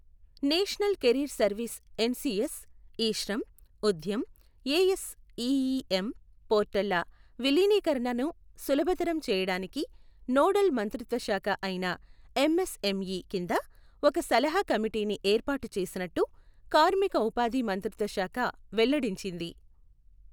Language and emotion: Telugu, neutral